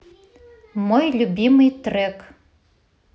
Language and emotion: Russian, positive